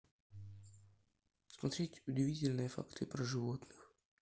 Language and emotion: Russian, neutral